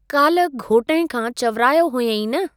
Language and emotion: Sindhi, neutral